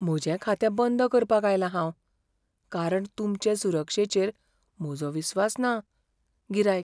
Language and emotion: Goan Konkani, fearful